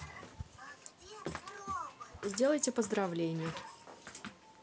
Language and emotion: Russian, neutral